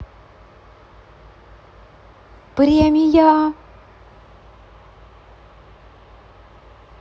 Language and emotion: Russian, positive